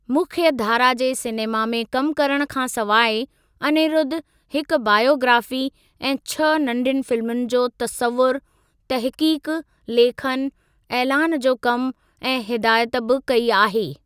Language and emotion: Sindhi, neutral